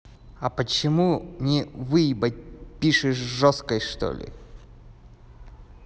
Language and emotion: Russian, angry